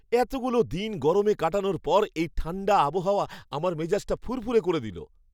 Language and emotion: Bengali, happy